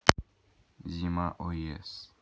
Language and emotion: Russian, neutral